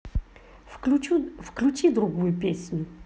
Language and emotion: Russian, neutral